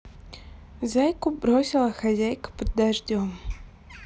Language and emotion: Russian, neutral